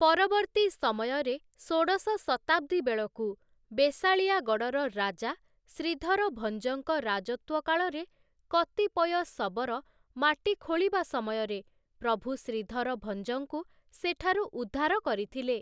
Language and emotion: Odia, neutral